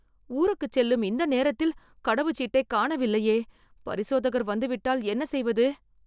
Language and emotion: Tamil, fearful